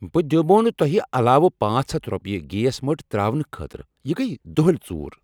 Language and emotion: Kashmiri, angry